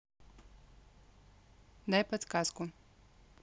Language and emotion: Russian, neutral